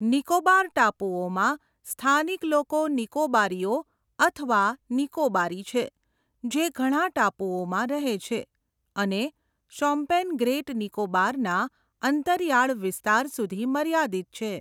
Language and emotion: Gujarati, neutral